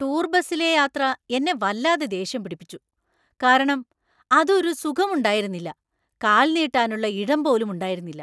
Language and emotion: Malayalam, angry